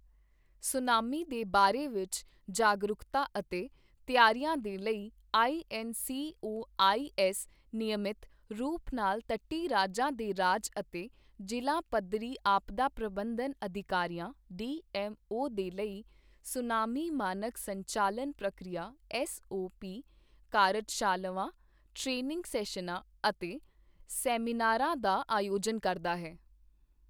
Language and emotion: Punjabi, neutral